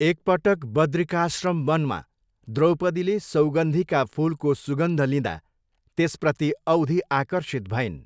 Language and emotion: Nepali, neutral